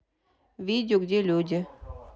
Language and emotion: Russian, neutral